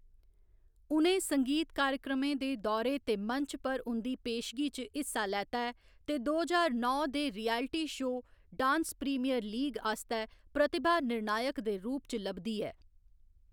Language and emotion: Dogri, neutral